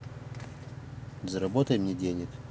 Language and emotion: Russian, neutral